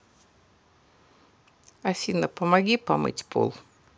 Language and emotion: Russian, neutral